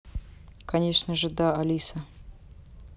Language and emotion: Russian, neutral